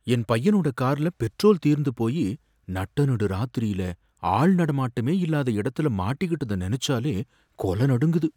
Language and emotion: Tamil, fearful